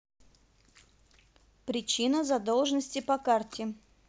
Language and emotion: Russian, neutral